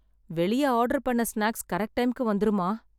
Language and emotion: Tamil, sad